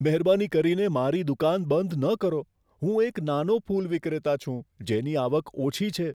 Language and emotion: Gujarati, fearful